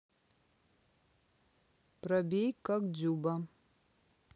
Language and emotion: Russian, neutral